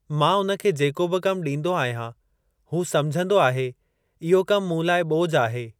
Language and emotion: Sindhi, neutral